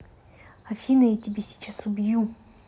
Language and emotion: Russian, angry